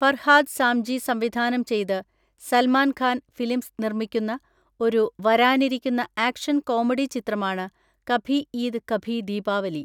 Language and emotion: Malayalam, neutral